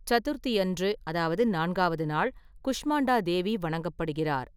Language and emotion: Tamil, neutral